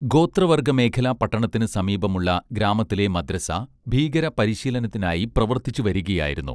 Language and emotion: Malayalam, neutral